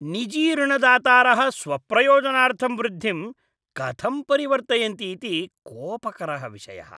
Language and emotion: Sanskrit, disgusted